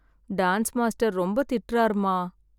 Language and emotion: Tamil, sad